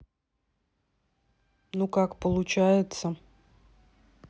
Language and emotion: Russian, neutral